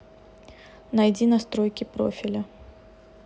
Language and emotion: Russian, neutral